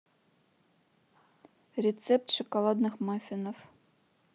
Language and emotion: Russian, neutral